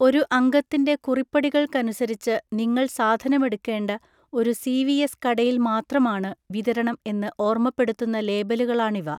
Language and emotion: Malayalam, neutral